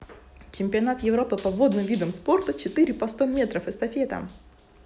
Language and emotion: Russian, neutral